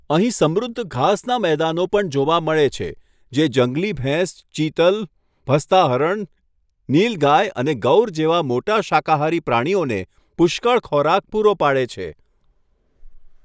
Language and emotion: Gujarati, neutral